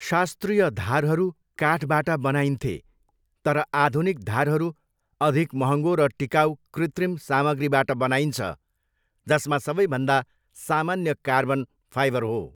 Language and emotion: Nepali, neutral